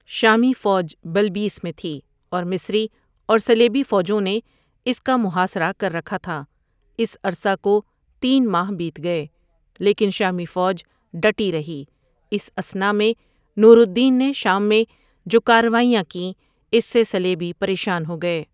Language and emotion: Urdu, neutral